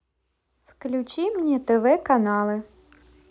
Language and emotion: Russian, positive